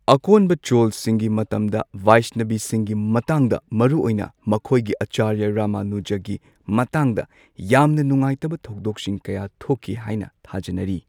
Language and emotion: Manipuri, neutral